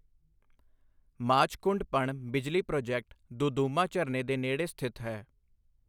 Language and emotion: Punjabi, neutral